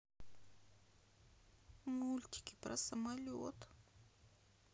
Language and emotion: Russian, sad